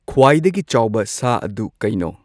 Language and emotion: Manipuri, neutral